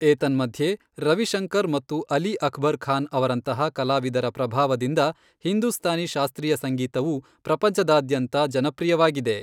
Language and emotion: Kannada, neutral